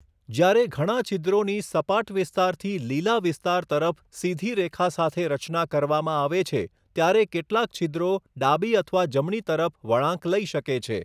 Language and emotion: Gujarati, neutral